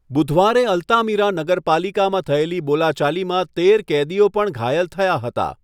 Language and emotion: Gujarati, neutral